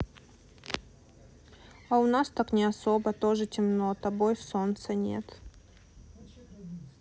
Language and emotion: Russian, sad